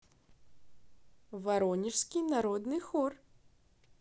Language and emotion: Russian, positive